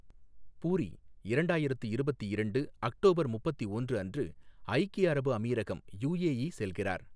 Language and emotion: Tamil, neutral